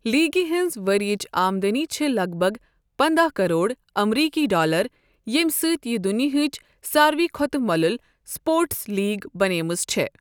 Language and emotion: Kashmiri, neutral